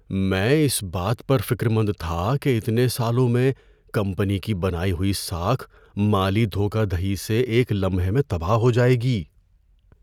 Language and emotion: Urdu, fearful